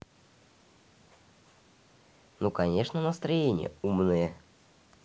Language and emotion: Russian, neutral